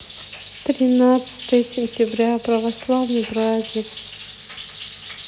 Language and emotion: Russian, sad